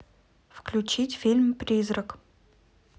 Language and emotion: Russian, neutral